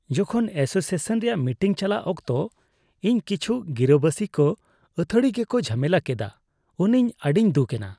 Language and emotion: Santali, disgusted